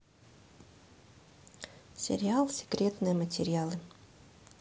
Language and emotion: Russian, neutral